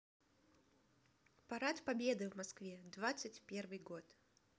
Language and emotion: Russian, positive